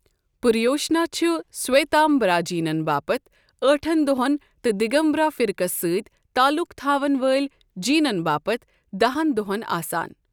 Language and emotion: Kashmiri, neutral